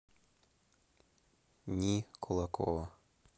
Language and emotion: Russian, neutral